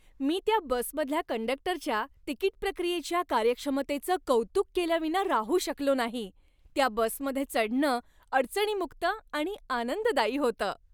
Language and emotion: Marathi, happy